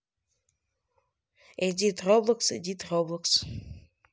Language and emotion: Russian, neutral